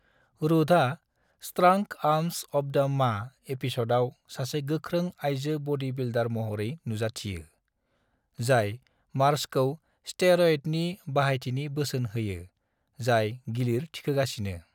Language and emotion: Bodo, neutral